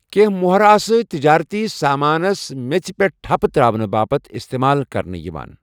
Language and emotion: Kashmiri, neutral